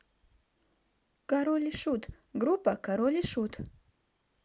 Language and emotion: Russian, neutral